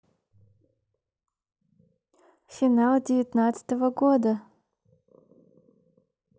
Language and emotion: Russian, neutral